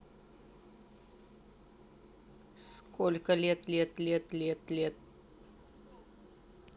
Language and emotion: Russian, neutral